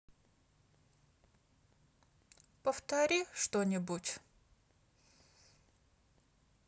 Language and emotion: Russian, sad